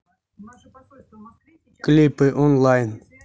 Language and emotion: Russian, neutral